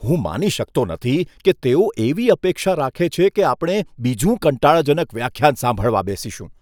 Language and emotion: Gujarati, disgusted